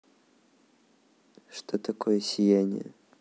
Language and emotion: Russian, neutral